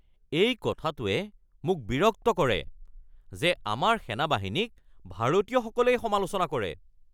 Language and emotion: Assamese, angry